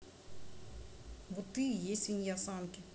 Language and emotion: Russian, angry